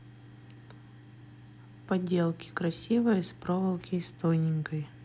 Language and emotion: Russian, neutral